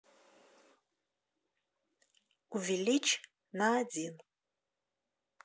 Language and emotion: Russian, neutral